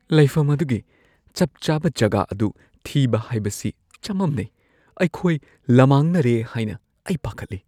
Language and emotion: Manipuri, fearful